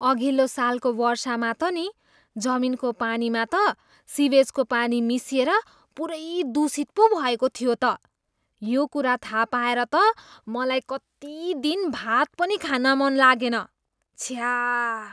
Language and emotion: Nepali, disgusted